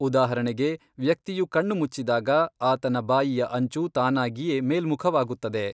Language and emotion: Kannada, neutral